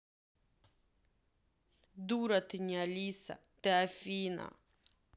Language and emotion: Russian, angry